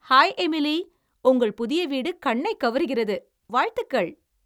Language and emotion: Tamil, happy